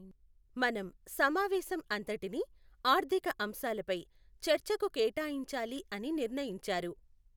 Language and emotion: Telugu, neutral